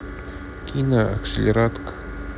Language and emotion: Russian, neutral